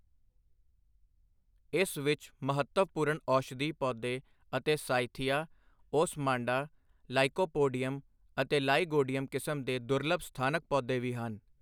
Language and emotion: Punjabi, neutral